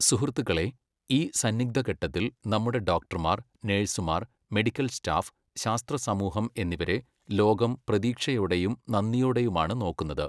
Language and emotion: Malayalam, neutral